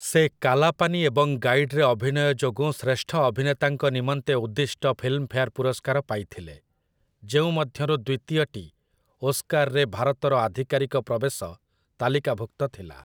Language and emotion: Odia, neutral